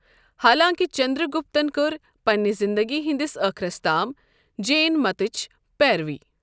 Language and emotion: Kashmiri, neutral